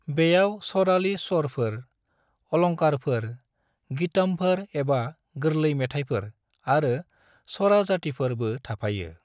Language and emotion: Bodo, neutral